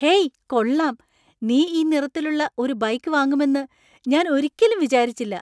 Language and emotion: Malayalam, surprised